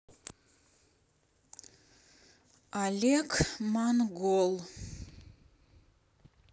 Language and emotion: Russian, neutral